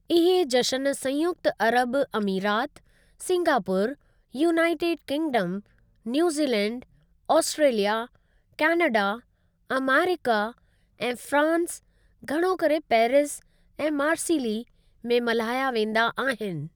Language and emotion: Sindhi, neutral